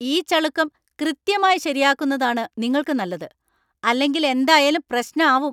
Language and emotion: Malayalam, angry